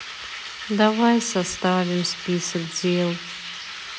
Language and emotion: Russian, sad